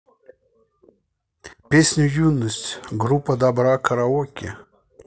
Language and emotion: Russian, neutral